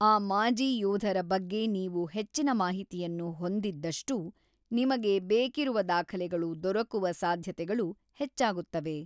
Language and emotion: Kannada, neutral